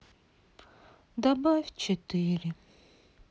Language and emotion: Russian, sad